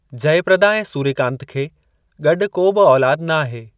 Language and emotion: Sindhi, neutral